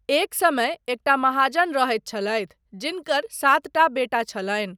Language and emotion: Maithili, neutral